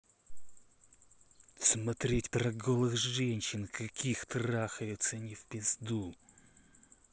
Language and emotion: Russian, angry